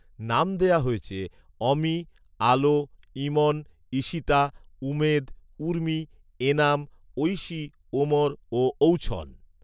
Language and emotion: Bengali, neutral